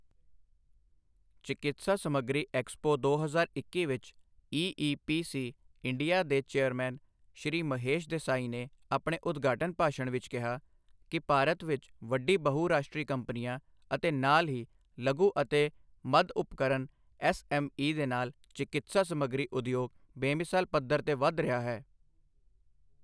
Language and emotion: Punjabi, neutral